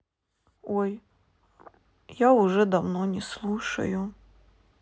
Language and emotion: Russian, sad